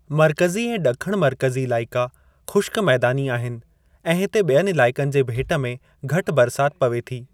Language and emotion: Sindhi, neutral